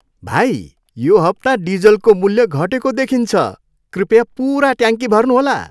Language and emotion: Nepali, happy